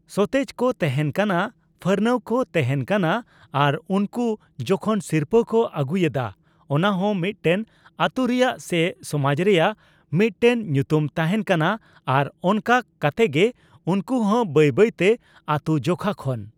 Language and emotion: Santali, neutral